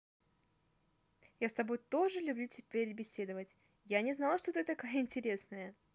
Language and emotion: Russian, positive